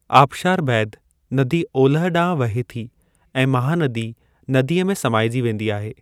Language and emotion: Sindhi, neutral